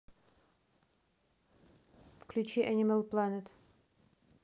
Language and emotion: Russian, neutral